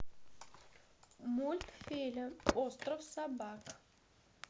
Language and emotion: Russian, neutral